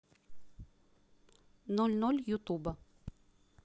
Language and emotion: Russian, neutral